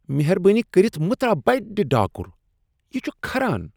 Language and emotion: Kashmiri, disgusted